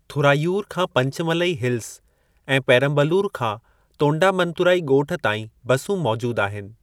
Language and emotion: Sindhi, neutral